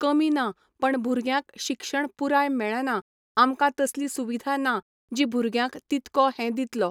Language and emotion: Goan Konkani, neutral